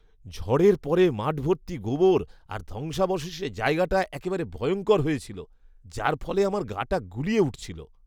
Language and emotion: Bengali, disgusted